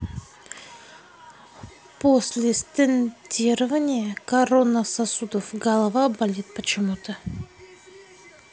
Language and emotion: Russian, neutral